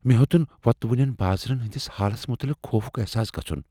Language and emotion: Kashmiri, fearful